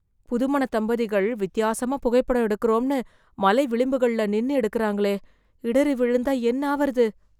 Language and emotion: Tamil, fearful